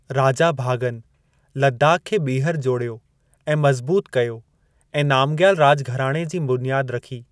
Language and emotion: Sindhi, neutral